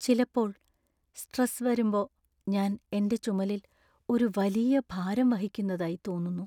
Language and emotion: Malayalam, sad